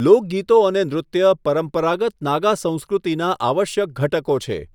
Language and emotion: Gujarati, neutral